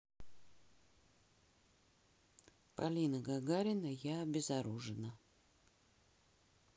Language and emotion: Russian, neutral